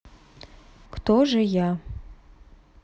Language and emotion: Russian, neutral